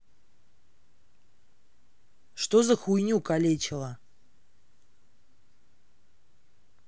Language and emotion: Russian, angry